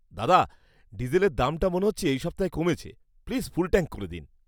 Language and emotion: Bengali, happy